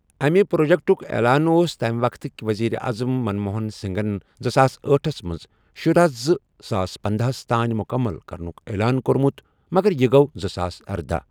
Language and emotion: Kashmiri, neutral